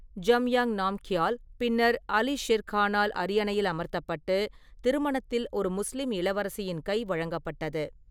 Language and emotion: Tamil, neutral